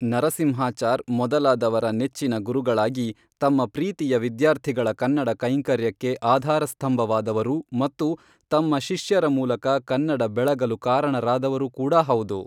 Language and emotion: Kannada, neutral